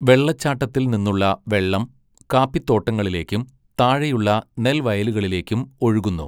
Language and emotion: Malayalam, neutral